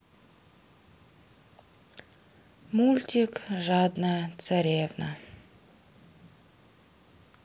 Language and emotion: Russian, sad